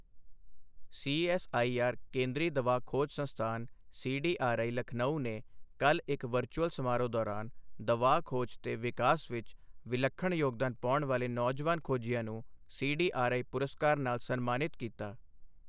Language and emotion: Punjabi, neutral